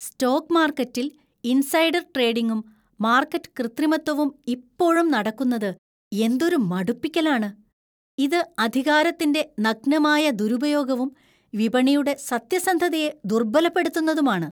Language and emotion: Malayalam, disgusted